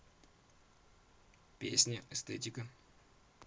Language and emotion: Russian, neutral